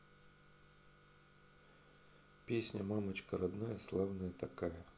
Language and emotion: Russian, neutral